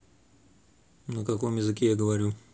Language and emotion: Russian, neutral